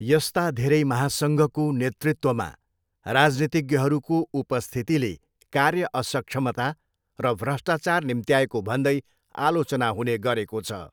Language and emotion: Nepali, neutral